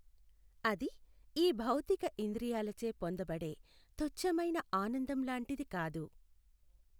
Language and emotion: Telugu, neutral